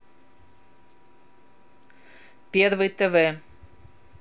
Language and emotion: Russian, neutral